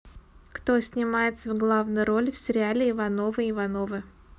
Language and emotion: Russian, neutral